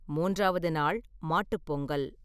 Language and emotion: Tamil, neutral